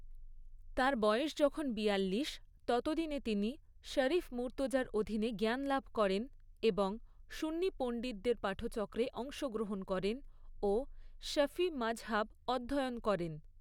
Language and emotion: Bengali, neutral